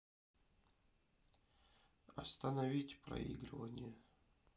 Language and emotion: Russian, sad